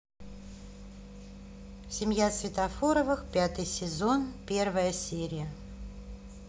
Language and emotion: Russian, neutral